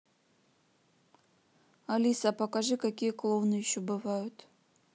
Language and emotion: Russian, neutral